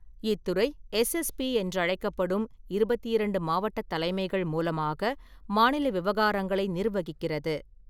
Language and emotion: Tamil, neutral